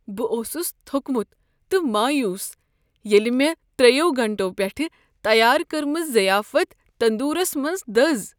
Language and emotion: Kashmiri, sad